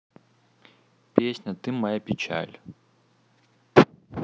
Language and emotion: Russian, neutral